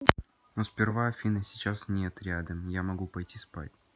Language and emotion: Russian, neutral